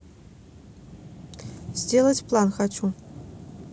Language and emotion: Russian, neutral